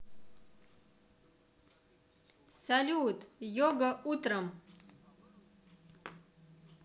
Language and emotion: Russian, positive